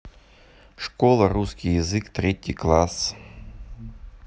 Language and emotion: Russian, neutral